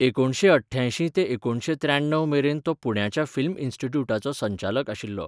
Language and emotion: Goan Konkani, neutral